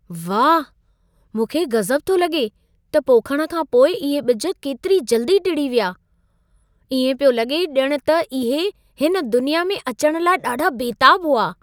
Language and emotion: Sindhi, surprised